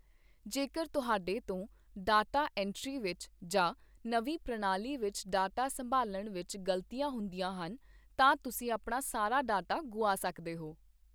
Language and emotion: Punjabi, neutral